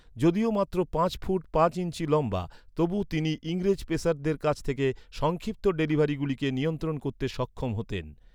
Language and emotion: Bengali, neutral